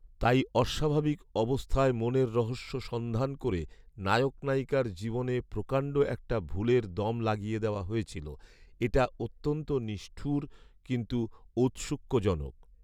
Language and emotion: Bengali, neutral